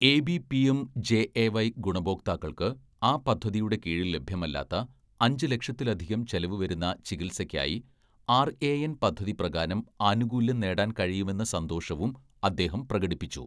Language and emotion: Malayalam, neutral